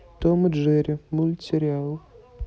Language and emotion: Russian, neutral